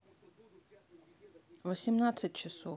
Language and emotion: Russian, neutral